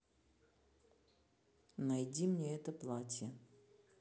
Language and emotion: Russian, neutral